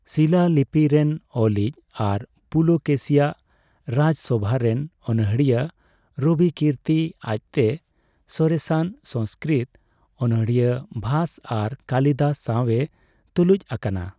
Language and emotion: Santali, neutral